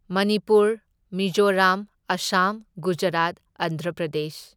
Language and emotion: Manipuri, neutral